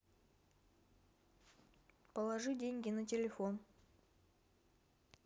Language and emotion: Russian, neutral